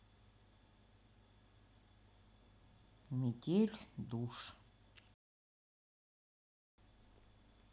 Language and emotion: Russian, neutral